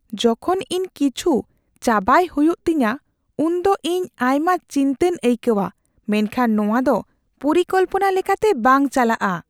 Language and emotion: Santali, fearful